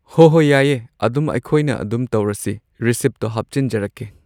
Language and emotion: Manipuri, neutral